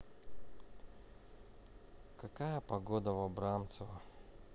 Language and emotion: Russian, sad